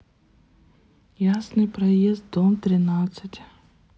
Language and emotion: Russian, sad